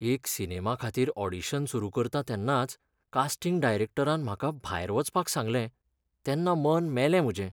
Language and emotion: Goan Konkani, sad